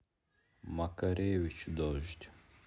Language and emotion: Russian, neutral